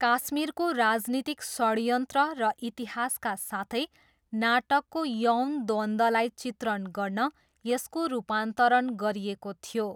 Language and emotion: Nepali, neutral